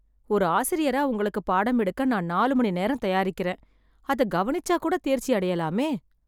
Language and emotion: Tamil, sad